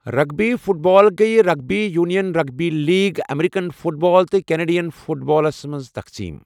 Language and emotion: Kashmiri, neutral